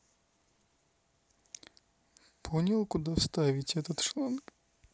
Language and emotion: Russian, neutral